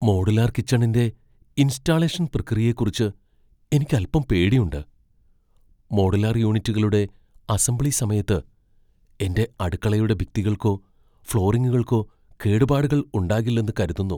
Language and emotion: Malayalam, fearful